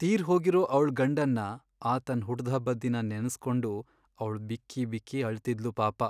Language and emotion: Kannada, sad